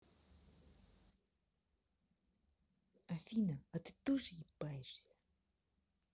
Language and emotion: Russian, angry